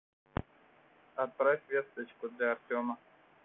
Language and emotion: Russian, neutral